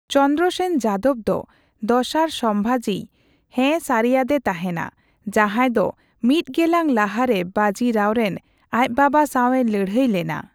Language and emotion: Santali, neutral